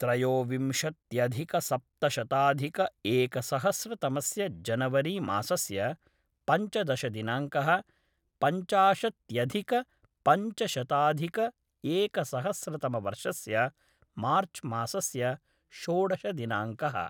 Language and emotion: Sanskrit, neutral